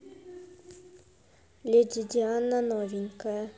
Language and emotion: Russian, neutral